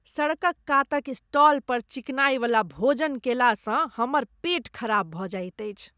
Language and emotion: Maithili, disgusted